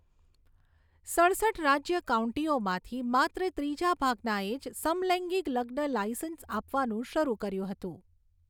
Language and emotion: Gujarati, neutral